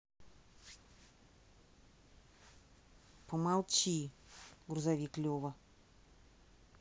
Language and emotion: Russian, angry